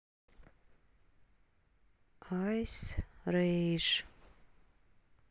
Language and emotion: Russian, neutral